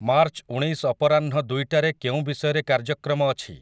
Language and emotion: Odia, neutral